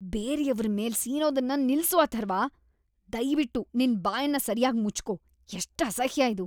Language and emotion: Kannada, disgusted